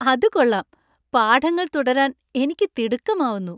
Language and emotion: Malayalam, happy